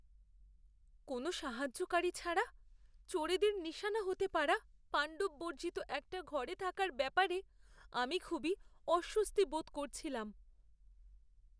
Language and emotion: Bengali, fearful